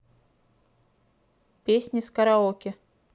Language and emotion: Russian, neutral